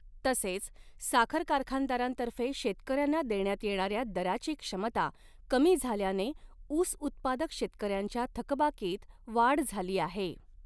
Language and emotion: Marathi, neutral